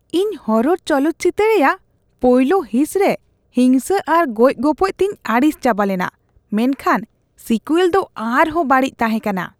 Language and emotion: Santali, disgusted